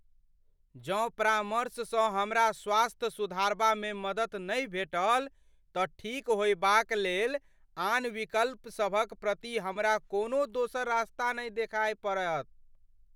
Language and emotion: Maithili, fearful